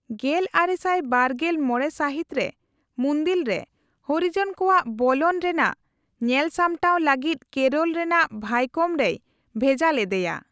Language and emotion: Santali, neutral